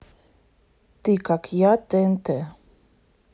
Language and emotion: Russian, neutral